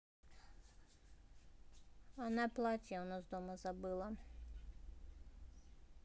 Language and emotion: Russian, neutral